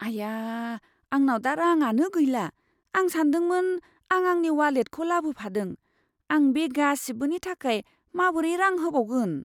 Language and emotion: Bodo, fearful